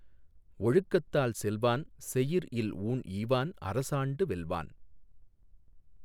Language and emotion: Tamil, neutral